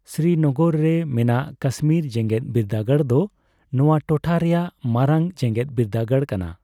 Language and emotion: Santali, neutral